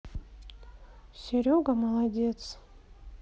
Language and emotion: Russian, sad